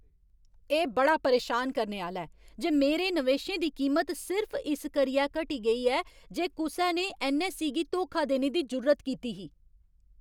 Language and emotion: Dogri, angry